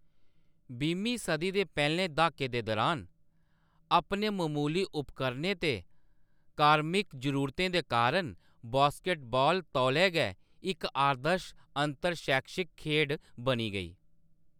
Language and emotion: Dogri, neutral